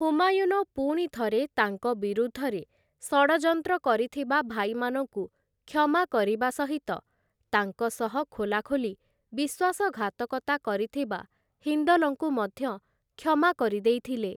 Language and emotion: Odia, neutral